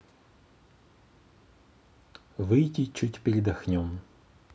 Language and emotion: Russian, neutral